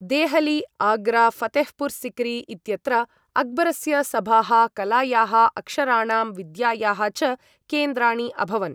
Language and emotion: Sanskrit, neutral